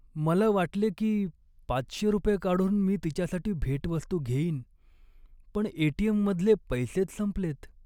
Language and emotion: Marathi, sad